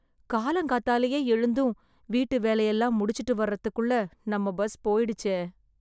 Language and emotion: Tamil, sad